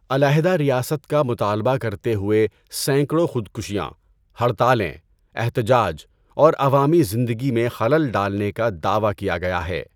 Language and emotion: Urdu, neutral